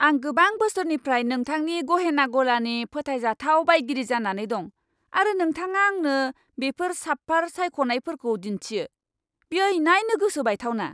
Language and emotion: Bodo, angry